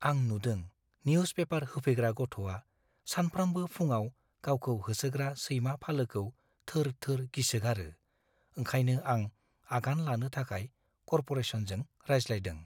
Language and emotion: Bodo, fearful